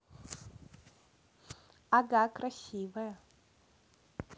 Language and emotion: Russian, neutral